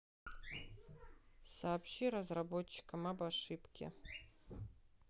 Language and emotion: Russian, neutral